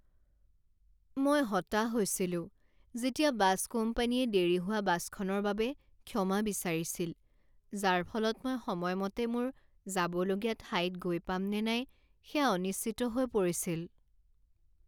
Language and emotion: Assamese, sad